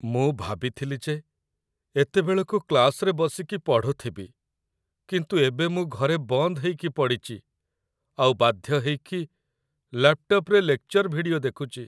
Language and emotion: Odia, sad